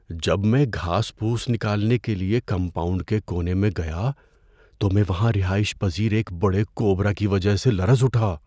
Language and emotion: Urdu, fearful